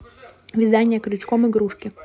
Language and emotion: Russian, neutral